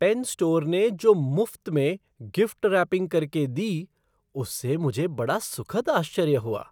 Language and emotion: Hindi, surprised